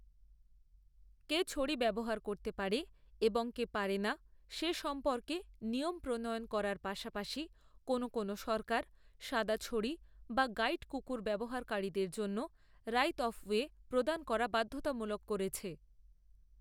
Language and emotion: Bengali, neutral